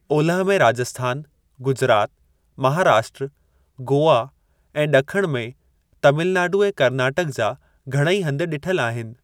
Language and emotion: Sindhi, neutral